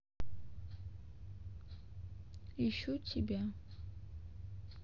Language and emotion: Russian, sad